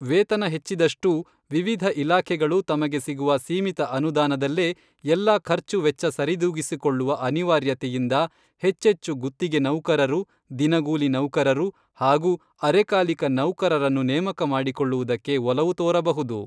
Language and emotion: Kannada, neutral